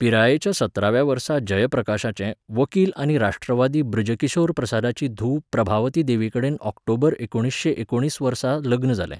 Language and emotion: Goan Konkani, neutral